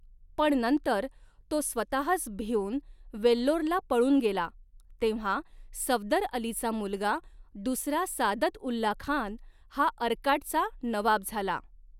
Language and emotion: Marathi, neutral